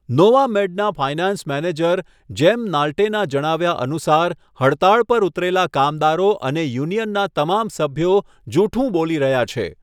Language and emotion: Gujarati, neutral